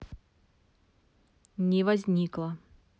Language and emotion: Russian, neutral